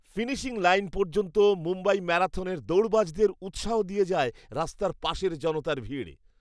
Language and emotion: Bengali, happy